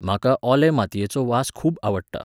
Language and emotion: Goan Konkani, neutral